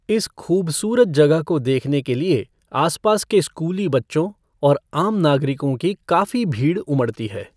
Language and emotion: Hindi, neutral